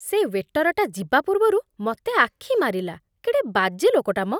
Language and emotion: Odia, disgusted